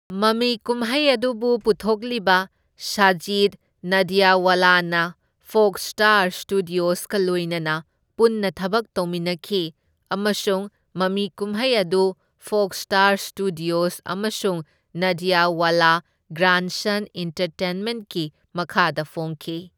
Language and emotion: Manipuri, neutral